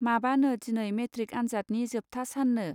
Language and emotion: Bodo, neutral